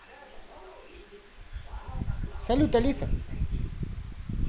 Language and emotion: Russian, positive